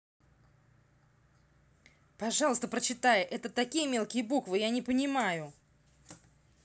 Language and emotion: Russian, angry